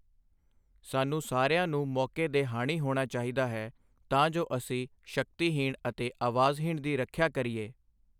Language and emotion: Punjabi, neutral